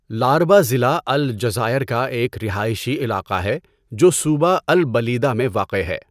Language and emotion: Urdu, neutral